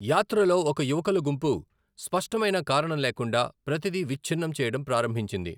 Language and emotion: Telugu, neutral